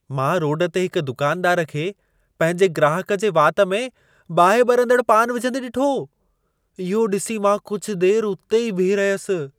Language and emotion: Sindhi, surprised